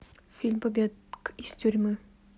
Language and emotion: Russian, neutral